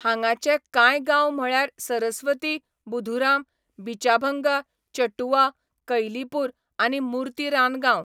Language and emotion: Goan Konkani, neutral